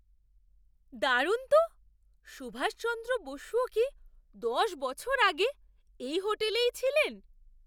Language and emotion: Bengali, surprised